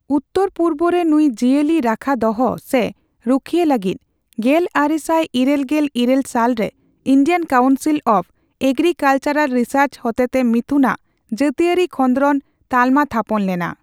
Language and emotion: Santali, neutral